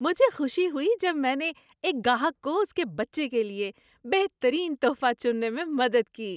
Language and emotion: Urdu, happy